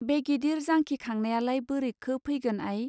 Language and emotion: Bodo, neutral